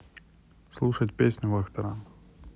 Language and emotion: Russian, neutral